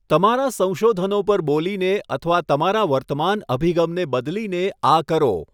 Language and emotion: Gujarati, neutral